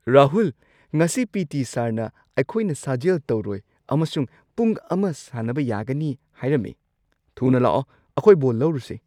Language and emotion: Manipuri, surprised